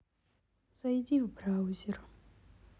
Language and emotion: Russian, sad